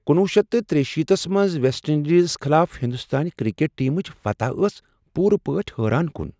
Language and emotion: Kashmiri, surprised